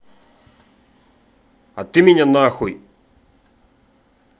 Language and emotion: Russian, angry